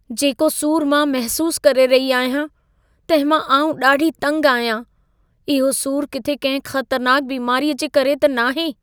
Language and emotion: Sindhi, fearful